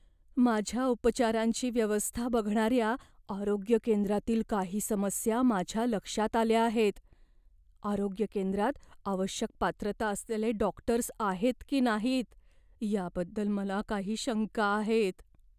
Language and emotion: Marathi, fearful